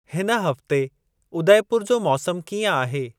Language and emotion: Sindhi, neutral